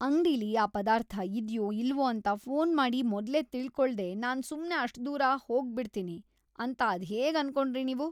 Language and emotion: Kannada, disgusted